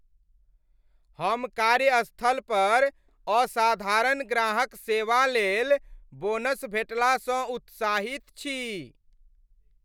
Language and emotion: Maithili, happy